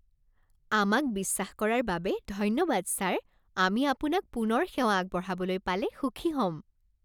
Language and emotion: Assamese, happy